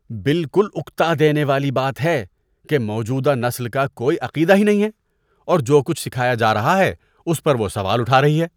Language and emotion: Urdu, disgusted